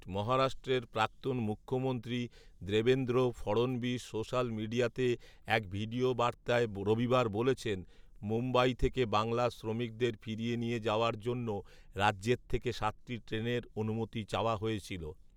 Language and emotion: Bengali, neutral